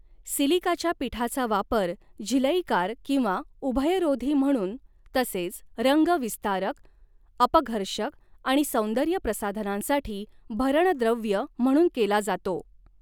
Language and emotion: Marathi, neutral